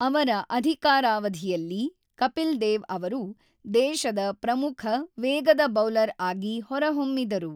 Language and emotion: Kannada, neutral